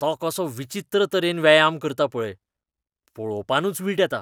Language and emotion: Goan Konkani, disgusted